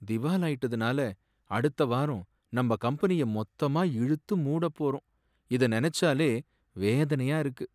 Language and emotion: Tamil, sad